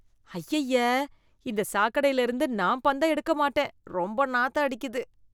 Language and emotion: Tamil, disgusted